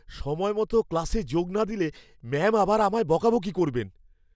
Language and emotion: Bengali, fearful